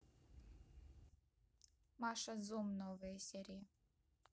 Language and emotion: Russian, neutral